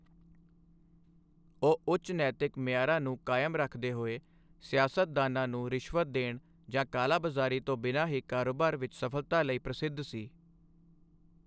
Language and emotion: Punjabi, neutral